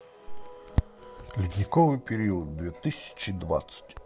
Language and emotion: Russian, positive